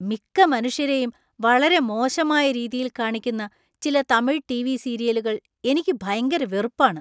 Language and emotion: Malayalam, disgusted